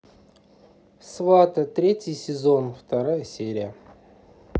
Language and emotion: Russian, neutral